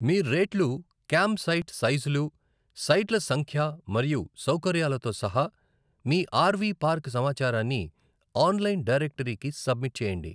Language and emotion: Telugu, neutral